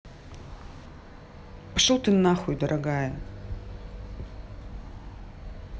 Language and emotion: Russian, angry